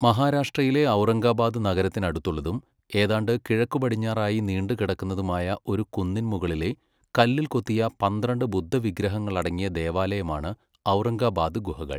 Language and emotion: Malayalam, neutral